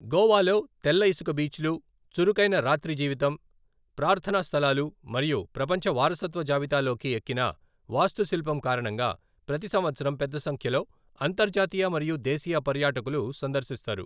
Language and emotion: Telugu, neutral